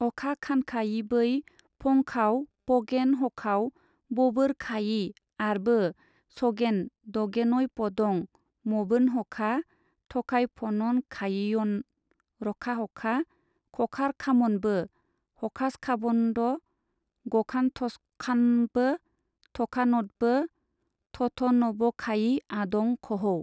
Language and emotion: Bodo, neutral